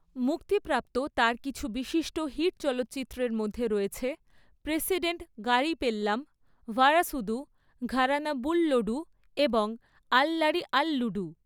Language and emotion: Bengali, neutral